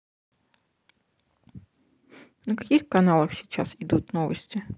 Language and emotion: Russian, neutral